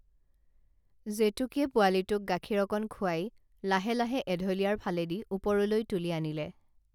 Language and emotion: Assamese, neutral